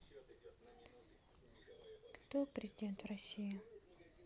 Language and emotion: Russian, neutral